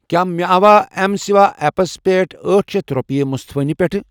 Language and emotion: Kashmiri, neutral